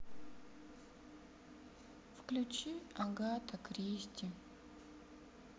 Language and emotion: Russian, sad